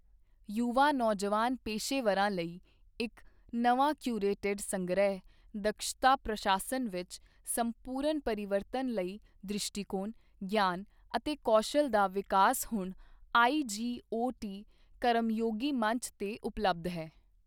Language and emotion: Punjabi, neutral